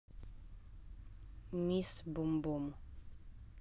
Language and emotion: Russian, neutral